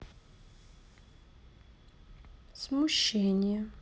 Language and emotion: Russian, neutral